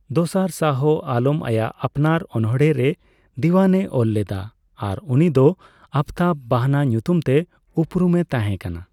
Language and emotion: Santali, neutral